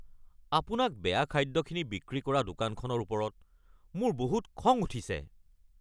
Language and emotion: Assamese, angry